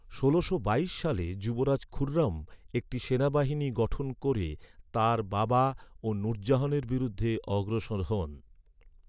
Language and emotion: Bengali, neutral